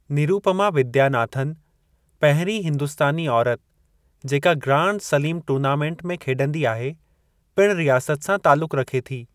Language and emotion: Sindhi, neutral